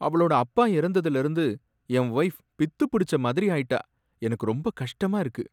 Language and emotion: Tamil, sad